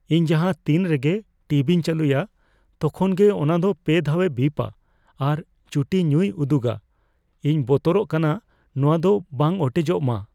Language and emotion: Santali, fearful